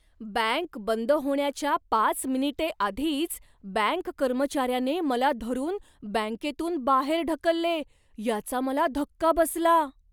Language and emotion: Marathi, surprised